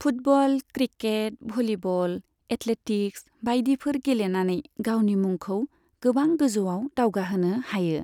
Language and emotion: Bodo, neutral